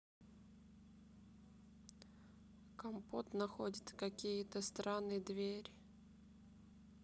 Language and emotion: Russian, neutral